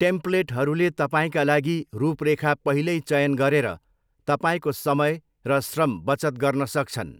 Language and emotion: Nepali, neutral